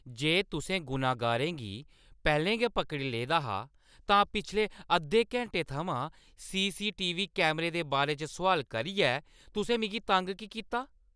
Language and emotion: Dogri, angry